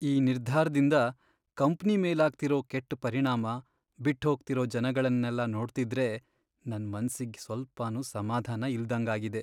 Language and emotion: Kannada, sad